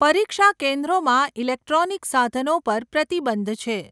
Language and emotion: Gujarati, neutral